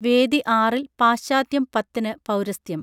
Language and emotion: Malayalam, neutral